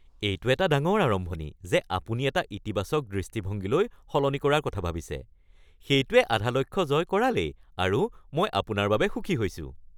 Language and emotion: Assamese, happy